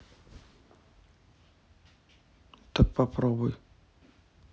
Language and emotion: Russian, neutral